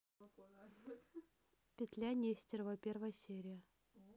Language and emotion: Russian, neutral